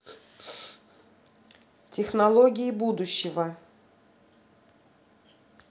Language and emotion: Russian, neutral